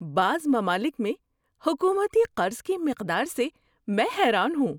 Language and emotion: Urdu, surprised